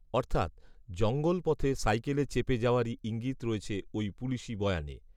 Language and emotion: Bengali, neutral